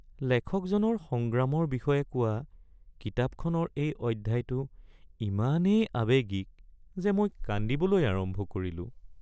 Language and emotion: Assamese, sad